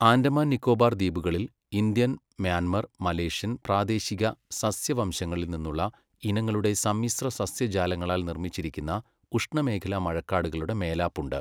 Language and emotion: Malayalam, neutral